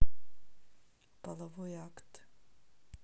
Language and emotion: Russian, neutral